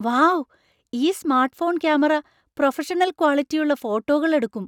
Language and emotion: Malayalam, surprised